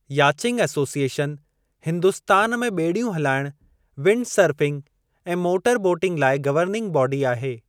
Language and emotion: Sindhi, neutral